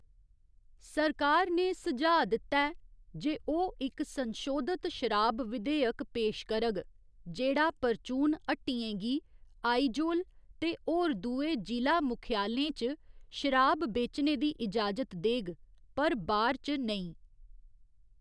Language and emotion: Dogri, neutral